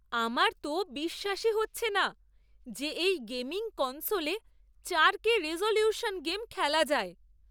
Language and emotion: Bengali, surprised